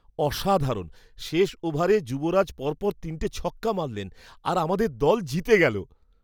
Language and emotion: Bengali, surprised